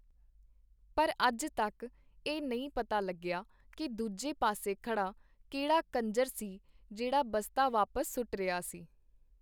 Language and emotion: Punjabi, neutral